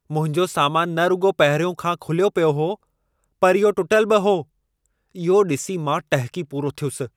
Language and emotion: Sindhi, angry